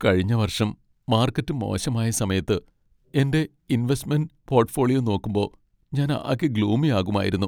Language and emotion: Malayalam, sad